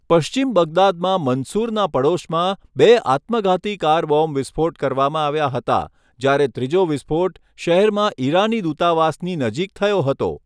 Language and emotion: Gujarati, neutral